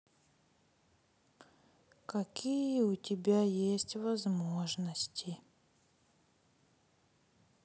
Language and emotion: Russian, sad